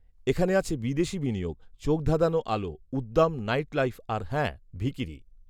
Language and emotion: Bengali, neutral